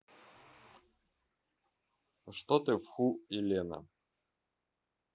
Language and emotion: Russian, neutral